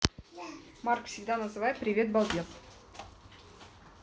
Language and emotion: Russian, neutral